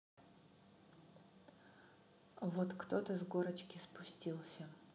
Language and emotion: Russian, neutral